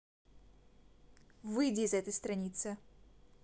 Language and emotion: Russian, angry